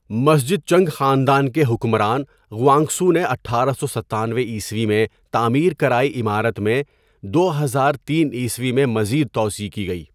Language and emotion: Urdu, neutral